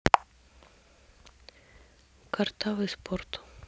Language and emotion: Russian, neutral